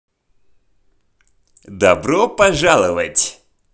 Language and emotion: Russian, positive